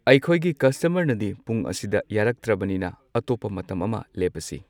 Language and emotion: Manipuri, neutral